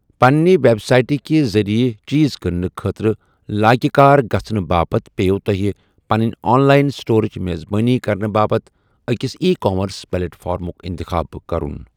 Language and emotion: Kashmiri, neutral